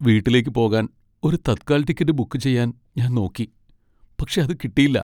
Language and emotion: Malayalam, sad